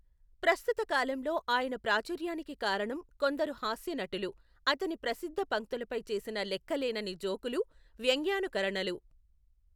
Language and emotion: Telugu, neutral